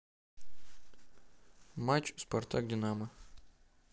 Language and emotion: Russian, neutral